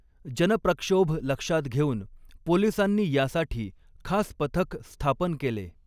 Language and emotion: Marathi, neutral